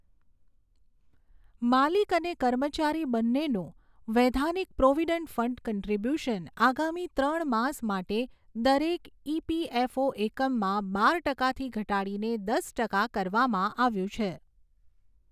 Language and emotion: Gujarati, neutral